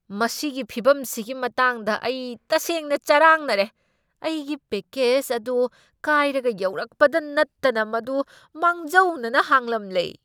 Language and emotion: Manipuri, angry